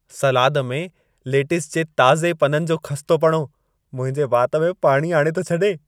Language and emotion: Sindhi, happy